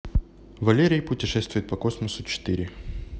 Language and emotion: Russian, neutral